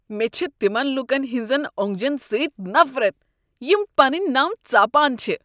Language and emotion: Kashmiri, disgusted